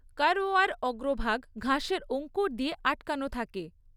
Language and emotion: Bengali, neutral